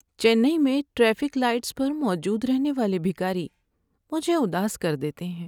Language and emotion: Urdu, sad